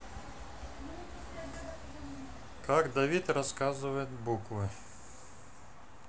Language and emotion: Russian, neutral